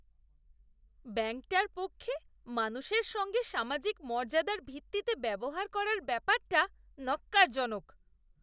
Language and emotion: Bengali, disgusted